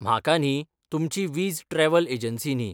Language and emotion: Goan Konkani, neutral